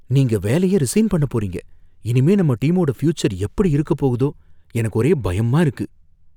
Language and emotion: Tamil, fearful